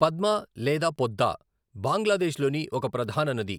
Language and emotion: Telugu, neutral